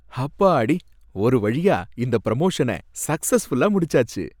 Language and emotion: Tamil, happy